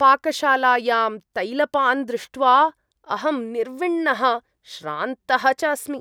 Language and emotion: Sanskrit, disgusted